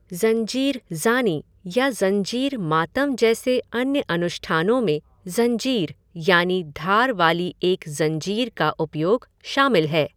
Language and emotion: Hindi, neutral